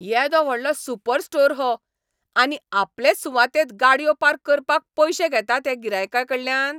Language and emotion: Goan Konkani, angry